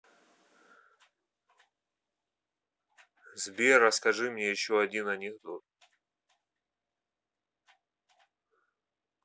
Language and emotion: Russian, neutral